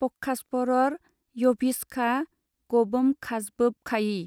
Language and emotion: Bodo, neutral